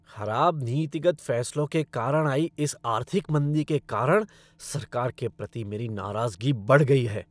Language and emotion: Hindi, angry